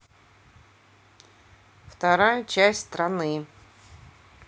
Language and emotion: Russian, neutral